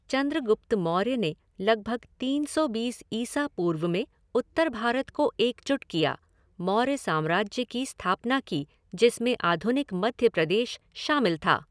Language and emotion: Hindi, neutral